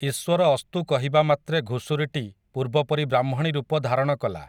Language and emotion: Odia, neutral